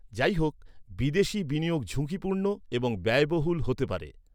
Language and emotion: Bengali, neutral